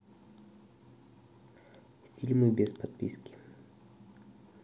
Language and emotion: Russian, neutral